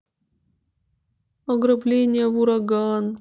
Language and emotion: Russian, sad